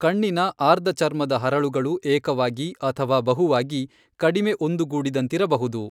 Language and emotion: Kannada, neutral